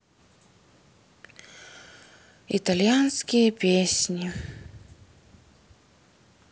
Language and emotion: Russian, sad